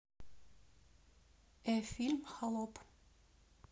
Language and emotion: Russian, neutral